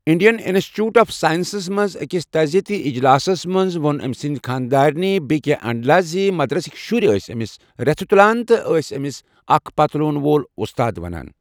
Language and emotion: Kashmiri, neutral